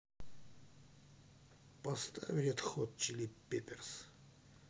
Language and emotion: Russian, neutral